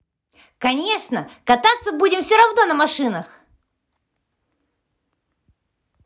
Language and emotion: Russian, positive